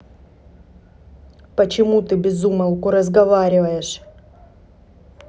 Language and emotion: Russian, angry